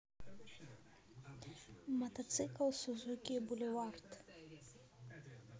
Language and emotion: Russian, neutral